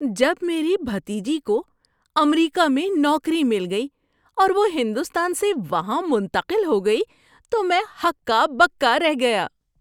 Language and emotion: Urdu, surprised